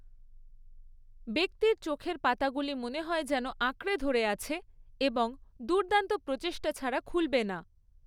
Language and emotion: Bengali, neutral